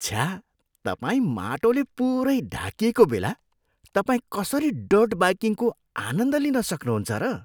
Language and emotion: Nepali, disgusted